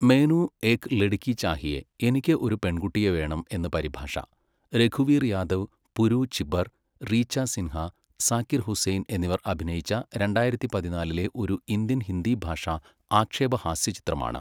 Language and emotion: Malayalam, neutral